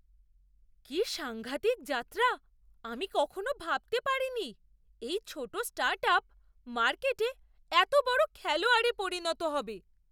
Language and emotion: Bengali, surprised